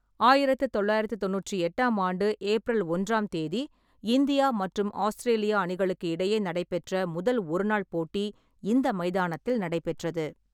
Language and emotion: Tamil, neutral